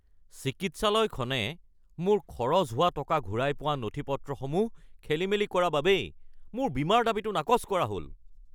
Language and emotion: Assamese, angry